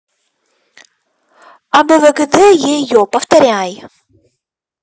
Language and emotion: Russian, angry